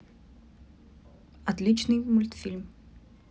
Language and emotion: Russian, neutral